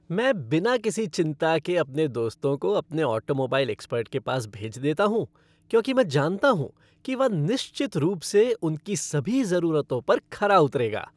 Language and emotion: Hindi, happy